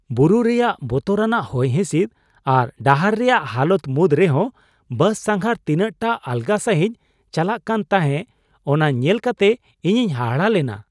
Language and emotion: Santali, surprised